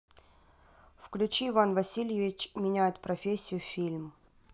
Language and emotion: Russian, neutral